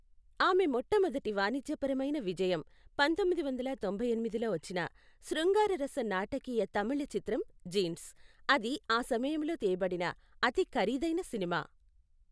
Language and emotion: Telugu, neutral